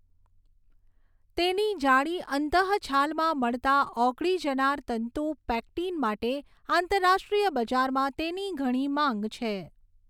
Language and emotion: Gujarati, neutral